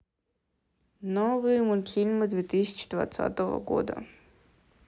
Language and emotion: Russian, neutral